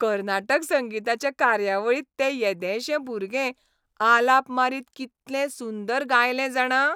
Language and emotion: Goan Konkani, happy